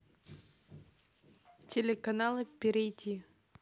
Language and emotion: Russian, neutral